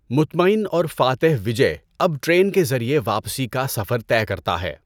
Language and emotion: Urdu, neutral